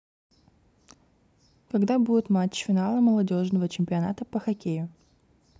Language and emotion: Russian, neutral